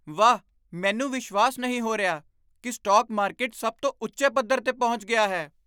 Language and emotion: Punjabi, surprised